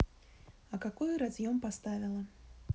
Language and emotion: Russian, neutral